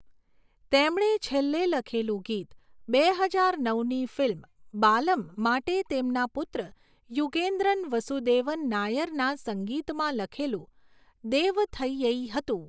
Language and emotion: Gujarati, neutral